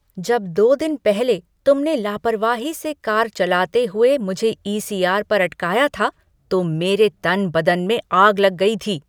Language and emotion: Hindi, angry